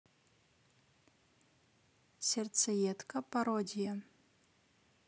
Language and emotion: Russian, neutral